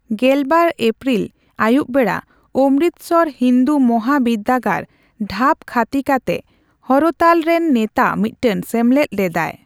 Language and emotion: Santali, neutral